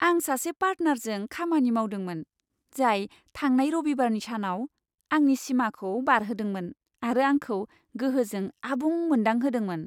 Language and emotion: Bodo, happy